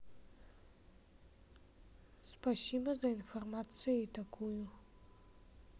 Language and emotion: Russian, neutral